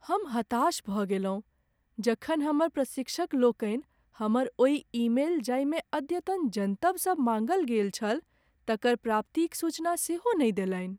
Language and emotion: Maithili, sad